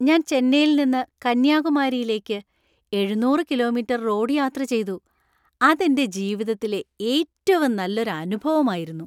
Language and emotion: Malayalam, happy